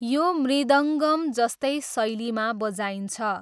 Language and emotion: Nepali, neutral